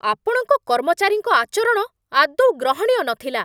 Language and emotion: Odia, angry